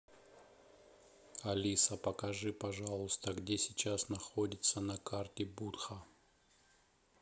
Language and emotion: Russian, neutral